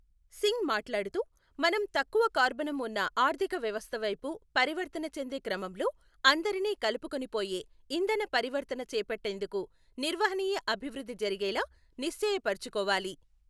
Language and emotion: Telugu, neutral